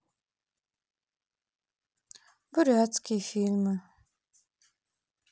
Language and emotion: Russian, neutral